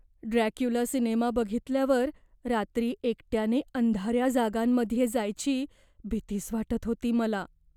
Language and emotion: Marathi, fearful